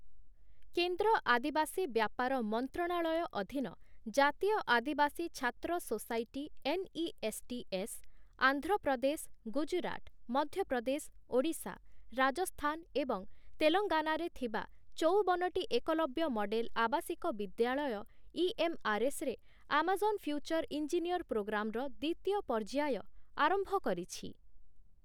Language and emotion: Odia, neutral